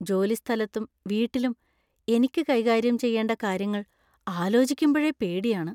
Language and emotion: Malayalam, fearful